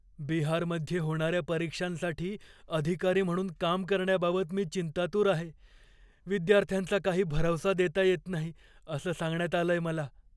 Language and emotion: Marathi, fearful